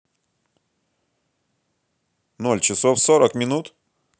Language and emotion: Russian, neutral